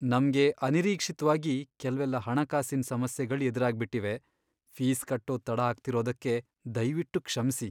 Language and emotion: Kannada, sad